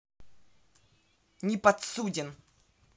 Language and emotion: Russian, angry